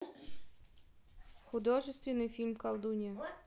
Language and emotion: Russian, neutral